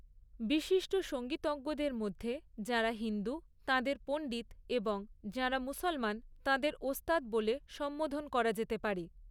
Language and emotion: Bengali, neutral